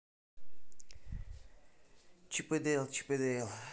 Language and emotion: Russian, neutral